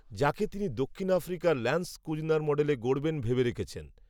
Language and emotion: Bengali, neutral